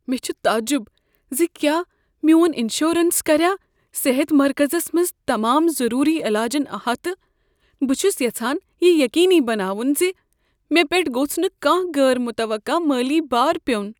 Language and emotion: Kashmiri, fearful